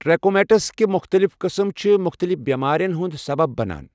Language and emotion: Kashmiri, neutral